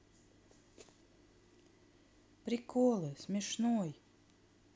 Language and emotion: Russian, neutral